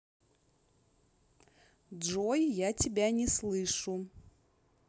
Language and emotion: Russian, neutral